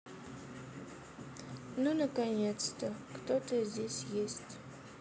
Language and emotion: Russian, sad